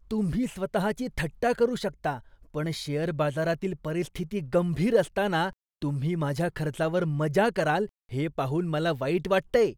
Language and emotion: Marathi, disgusted